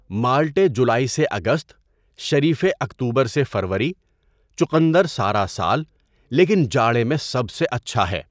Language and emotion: Urdu, neutral